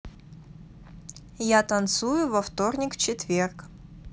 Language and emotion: Russian, neutral